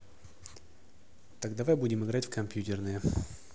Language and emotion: Russian, neutral